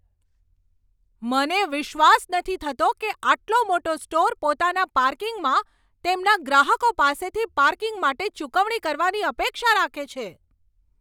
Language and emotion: Gujarati, angry